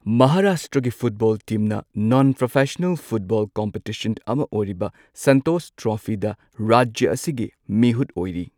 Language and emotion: Manipuri, neutral